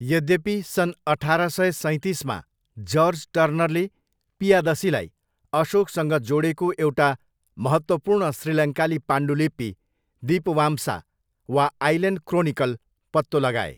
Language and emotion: Nepali, neutral